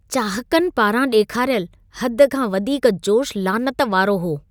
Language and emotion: Sindhi, disgusted